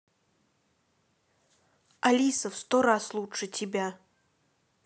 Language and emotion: Russian, angry